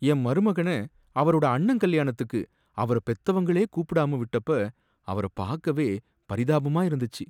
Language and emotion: Tamil, sad